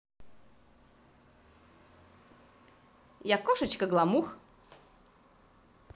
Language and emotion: Russian, positive